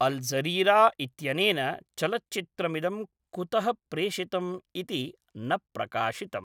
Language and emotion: Sanskrit, neutral